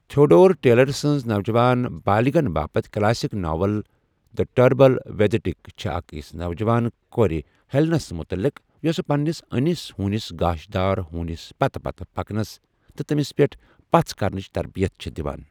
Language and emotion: Kashmiri, neutral